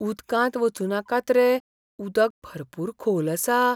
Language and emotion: Goan Konkani, fearful